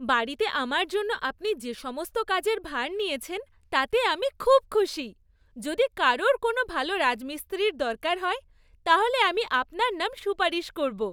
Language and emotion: Bengali, happy